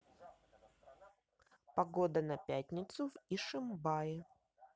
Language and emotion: Russian, neutral